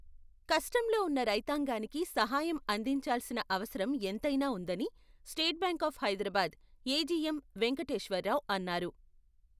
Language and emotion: Telugu, neutral